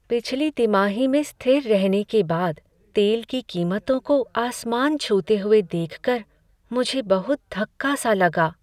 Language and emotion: Hindi, sad